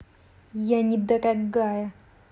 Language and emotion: Russian, angry